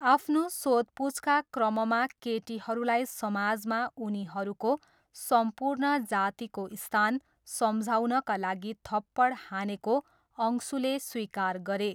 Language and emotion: Nepali, neutral